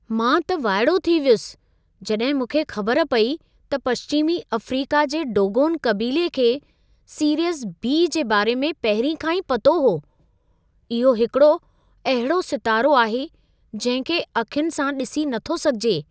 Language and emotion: Sindhi, surprised